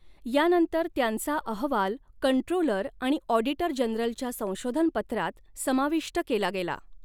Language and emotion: Marathi, neutral